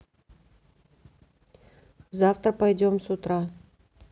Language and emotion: Russian, neutral